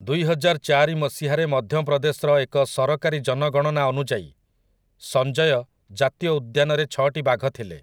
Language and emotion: Odia, neutral